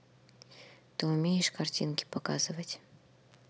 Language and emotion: Russian, neutral